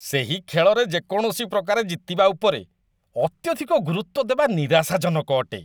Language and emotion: Odia, disgusted